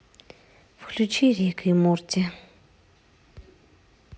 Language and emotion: Russian, neutral